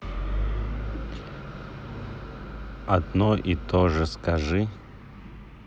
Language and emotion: Russian, neutral